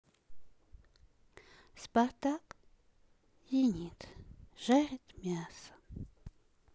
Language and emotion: Russian, neutral